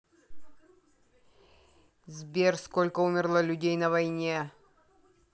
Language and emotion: Russian, angry